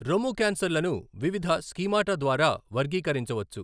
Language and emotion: Telugu, neutral